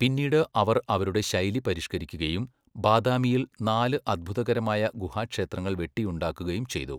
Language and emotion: Malayalam, neutral